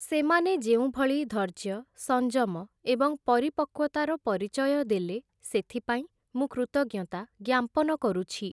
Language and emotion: Odia, neutral